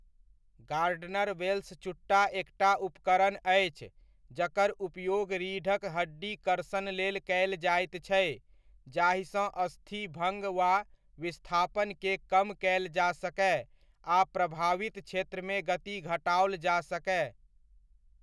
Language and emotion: Maithili, neutral